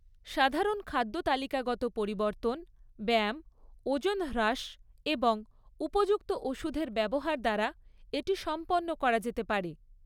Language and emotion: Bengali, neutral